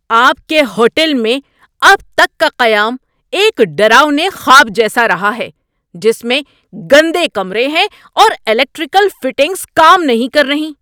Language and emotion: Urdu, angry